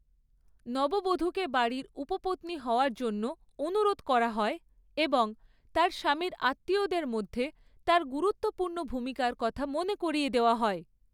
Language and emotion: Bengali, neutral